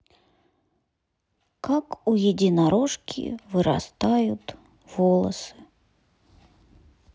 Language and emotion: Russian, sad